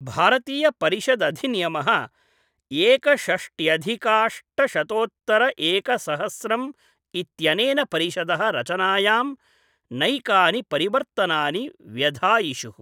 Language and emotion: Sanskrit, neutral